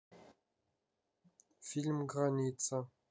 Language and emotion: Russian, neutral